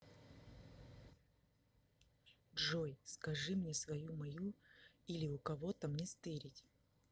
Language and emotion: Russian, neutral